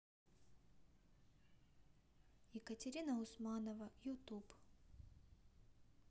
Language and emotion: Russian, neutral